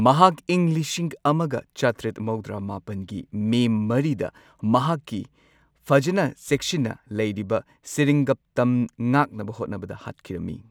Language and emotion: Manipuri, neutral